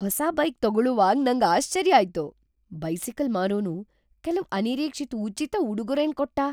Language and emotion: Kannada, surprised